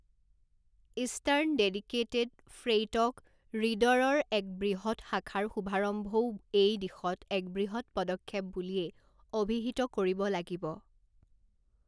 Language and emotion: Assamese, neutral